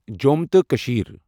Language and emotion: Kashmiri, neutral